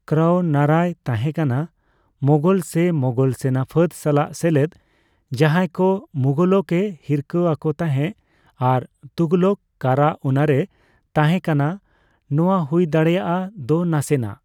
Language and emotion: Santali, neutral